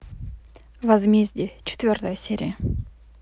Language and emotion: Russian, neutral